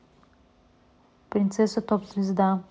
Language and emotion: Russian, neutral